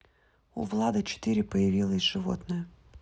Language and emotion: Russian, neutral